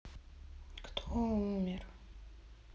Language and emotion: Russian, sad